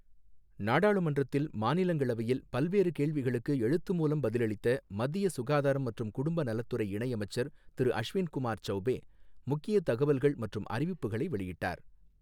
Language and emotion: Tamil, neutral